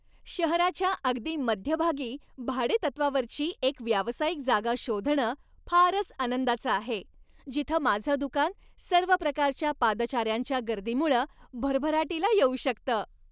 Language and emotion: Marathi, happy